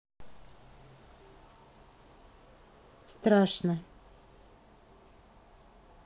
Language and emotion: Russian, neutral